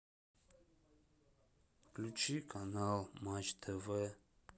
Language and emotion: Russian, sad